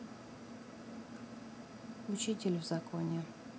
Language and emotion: Russian, neutral